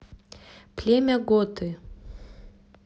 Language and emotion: Russian, neutral